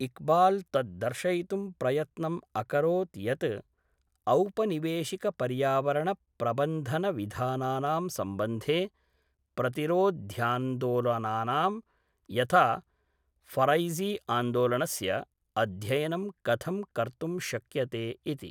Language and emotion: Sanskrit, neutral